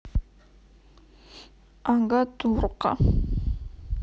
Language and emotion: Russian, sad